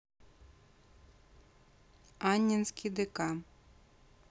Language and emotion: Russian, neutral